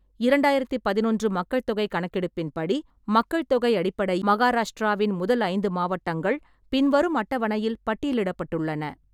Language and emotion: Tamil, neutral